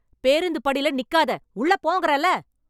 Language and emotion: Tamil, angry